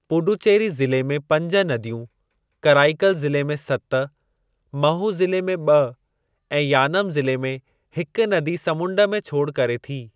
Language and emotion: Sindhi, neutral